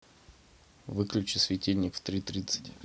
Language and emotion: Russian, neutral